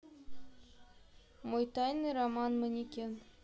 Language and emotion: Russian, neutral